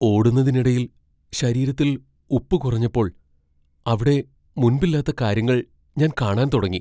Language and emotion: Malayalam, fearful